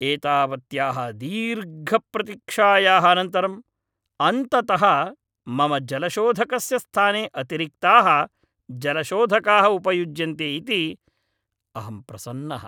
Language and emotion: Sanskrit, happy